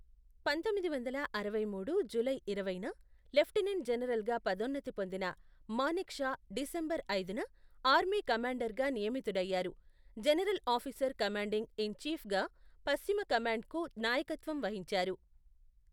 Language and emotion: Telugu, neutral